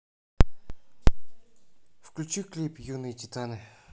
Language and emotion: Russian, neutral